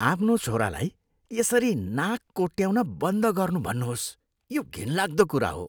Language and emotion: Nepali, disgusted